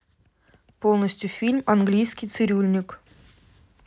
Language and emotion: Russian, neutral